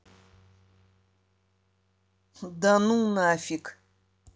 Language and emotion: Russian, neutral